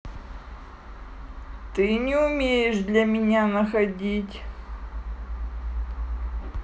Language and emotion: Russian, neutral